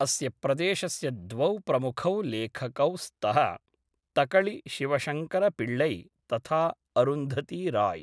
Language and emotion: Sanskrit, neutral